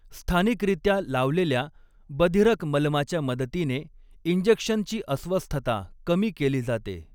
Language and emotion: Marathi, neutral